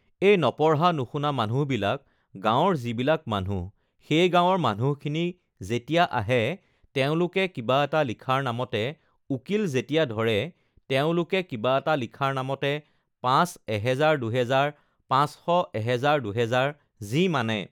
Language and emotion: Assamese, neutral